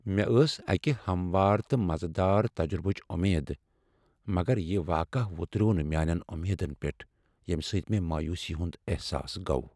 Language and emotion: Kashmiri, sad